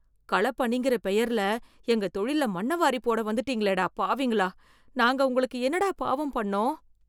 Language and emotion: Tamil, fearful